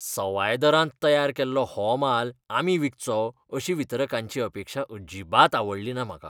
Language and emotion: Goan Konkani, disgusted